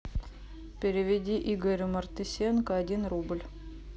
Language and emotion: Russian, neutral